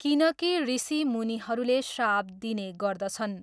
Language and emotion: Nepali, neutral